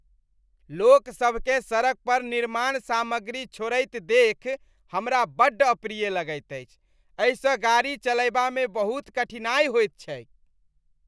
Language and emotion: Maithili, disgusted